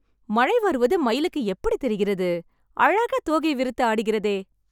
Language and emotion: Tamil, happy